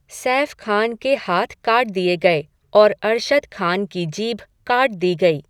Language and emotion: Hindi, neutral